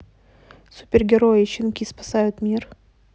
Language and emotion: Russian, neutral